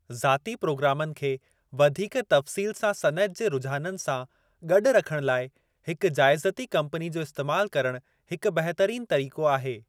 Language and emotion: Sindhi, neutral